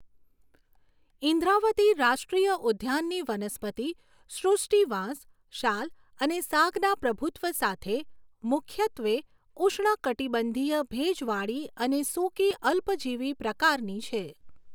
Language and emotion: Gujarati, neutral